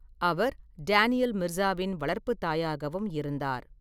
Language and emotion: Tamil, neutral